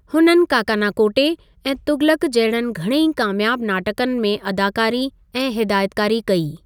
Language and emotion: Sindhi, neutral